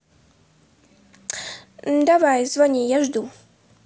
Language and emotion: Russian, neutral